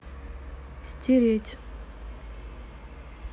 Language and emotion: Russian, neutral